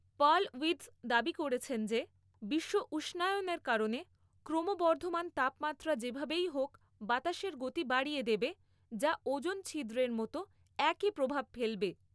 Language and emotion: Bengali, neutral